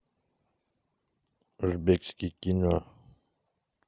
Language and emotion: Russian, neutral